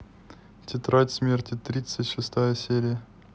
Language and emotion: Russian, neutral